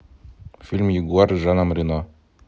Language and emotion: Russian, neutral